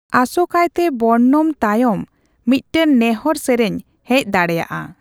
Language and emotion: Santali, neutral